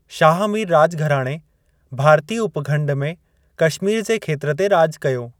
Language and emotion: Sindhi, neutral